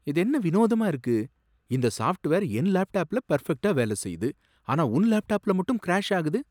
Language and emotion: Tamil, surprised